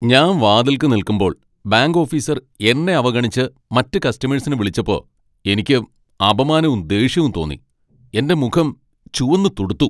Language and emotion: Malayalam, angry